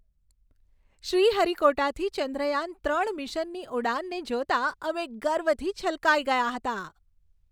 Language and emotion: Gujarati, happy